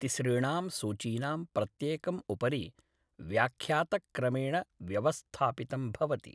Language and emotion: Sanskrit, neutral